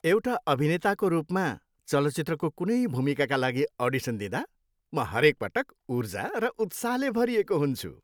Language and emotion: Nepali, happy